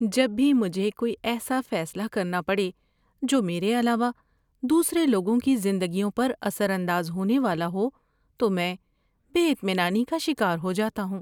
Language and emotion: Urdu, fearful